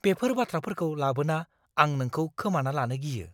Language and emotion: Bodo, fearful